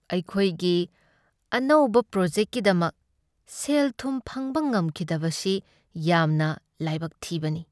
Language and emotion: Manipuri, sad